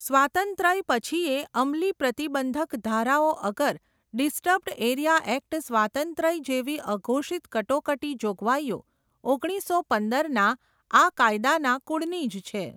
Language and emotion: Gujarati, neutral